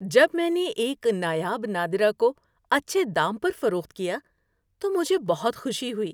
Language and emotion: Urdu, happy